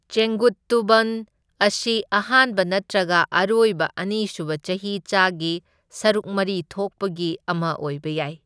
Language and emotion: Manipuri, neutral